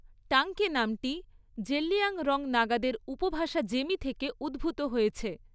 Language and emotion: Bengali, neutral